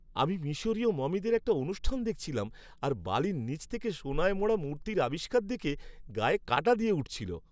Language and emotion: Bengali, happy